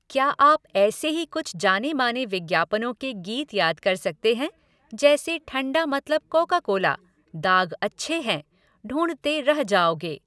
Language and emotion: Hindi, neutral